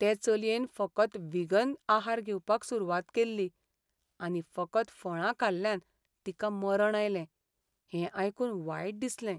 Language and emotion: Goan Konkani, sad